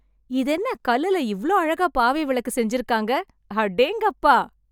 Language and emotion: Tamil, happy